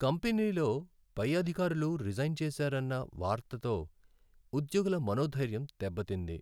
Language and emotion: Telugu, sad